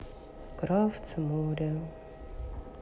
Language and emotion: Russian, sad